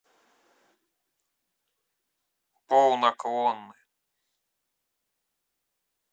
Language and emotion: Russian, neutral